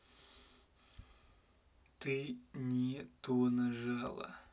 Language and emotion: Russian, neutral